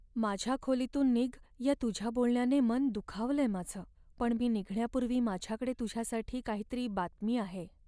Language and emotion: Marathi, sad